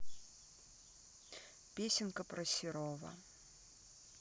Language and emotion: Russian, neutral